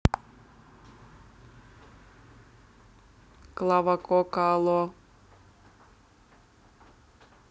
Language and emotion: Russian, neutral